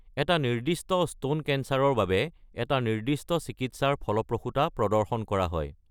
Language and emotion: Assamese, neutral